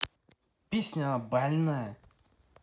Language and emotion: Russian, angry